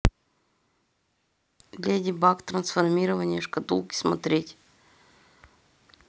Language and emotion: Russian, neutral